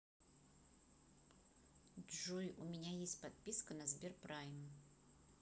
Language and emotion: Russian, neutral